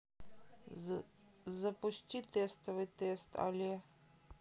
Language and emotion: Russian, neutral